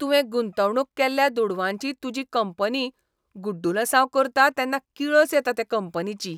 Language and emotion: Goan Konkani, disgusted